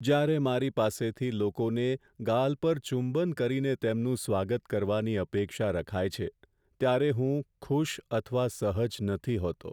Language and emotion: Gujarati, sad